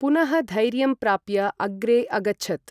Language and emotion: Sanskrit, neutral